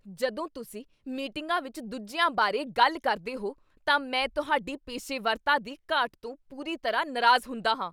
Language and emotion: Punjabi, angry